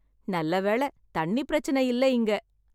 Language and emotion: Tamil, happy